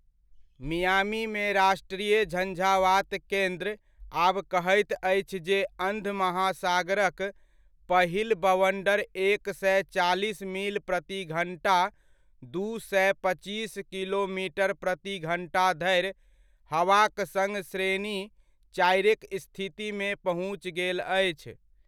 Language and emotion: Maithili, neutral